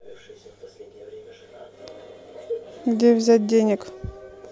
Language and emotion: Russian, neutral